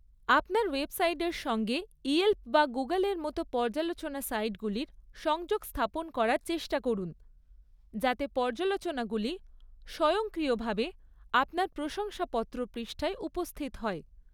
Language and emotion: Bengali, neutral